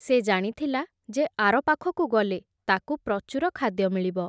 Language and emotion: Odia, neutral